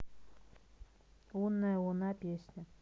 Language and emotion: Russian, neutral